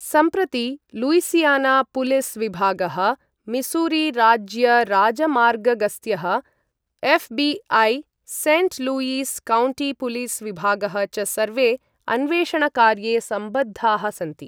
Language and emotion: Sanskrit, neutral